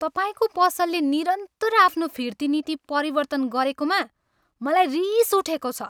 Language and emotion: Nepali, angry